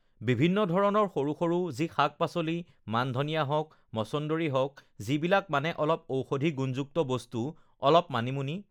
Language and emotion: Assamese, neutral